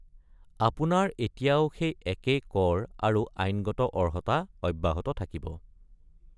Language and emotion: Assamese, neutral